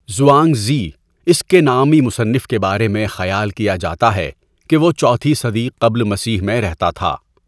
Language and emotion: Urdu, neutral